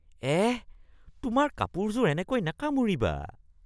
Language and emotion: Assamese, disgusted